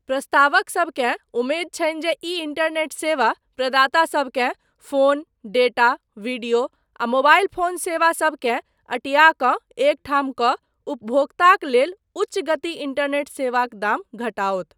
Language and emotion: Maithili, neutral